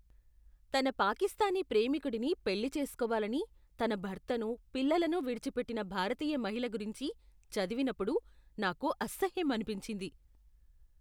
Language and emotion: Telugu, disgusted